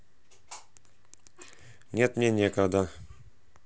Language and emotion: Russian, neutral